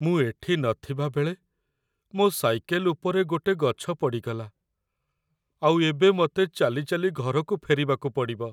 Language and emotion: Odia, sad